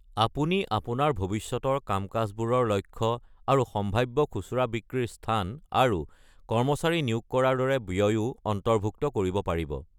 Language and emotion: Assamese, neutral